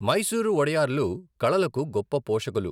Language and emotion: Telugu, neutral